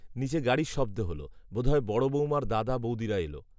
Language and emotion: Bengali, neutral